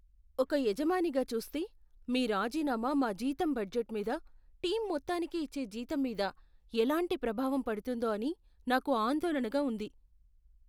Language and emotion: Telugu, fearful